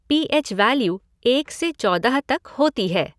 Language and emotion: Hindi, neutral